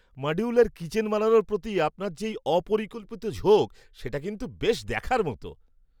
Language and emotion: Bengali, surprised